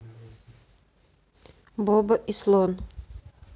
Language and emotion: Russian, neutral